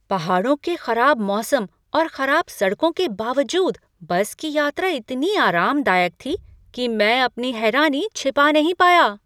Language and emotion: Hindi, surprised